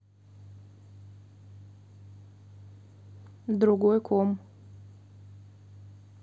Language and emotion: Russian, neutral